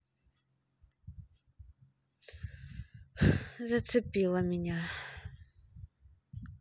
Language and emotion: Russian, sad